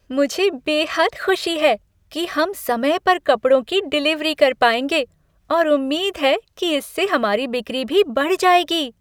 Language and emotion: Hindi, happy